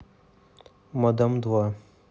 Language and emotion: Russian, neutral